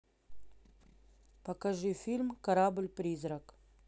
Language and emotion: Russian, neutral